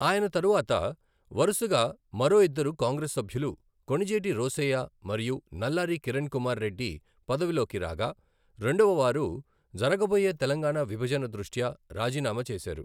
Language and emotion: Telugu, neutral